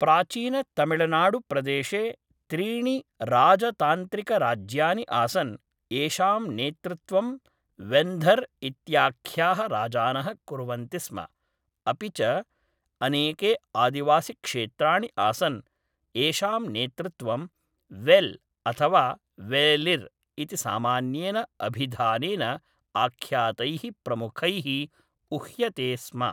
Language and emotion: Sanskrit, neutral